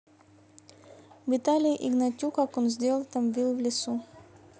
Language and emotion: Russian, neutral